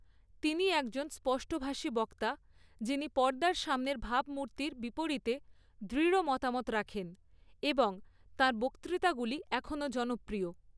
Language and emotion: Bengali, neutral